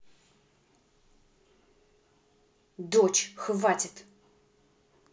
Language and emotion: Russian, angry